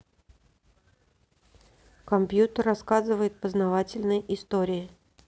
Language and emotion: Russian, neutral